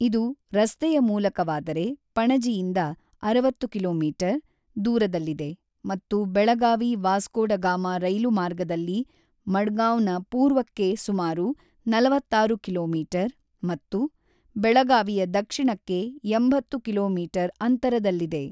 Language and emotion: Kannada, neutral